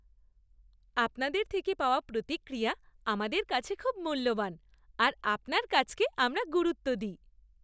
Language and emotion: Bengali, happy